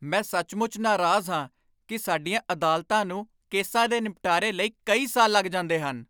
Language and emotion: Punjabi, angry